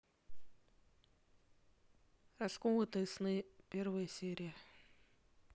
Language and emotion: Russian, neutral